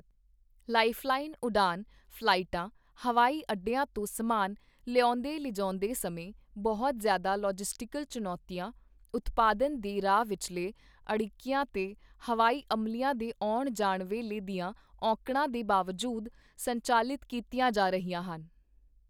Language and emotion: Punjabi, neutral